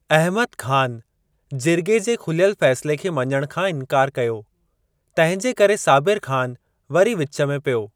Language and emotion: Sindhi, neutral